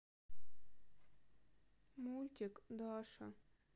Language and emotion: Russian, sad